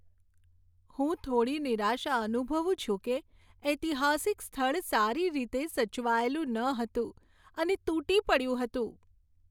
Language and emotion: Gujarati, sad